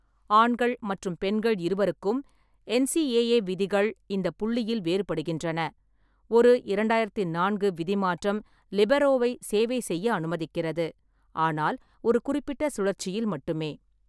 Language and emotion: Tamil, neutral